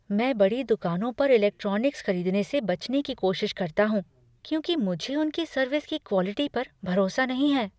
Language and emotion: Hindi, fearful